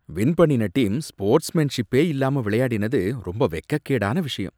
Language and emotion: Tamil, disgusted